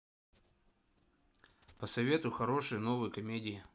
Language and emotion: Russian, neutral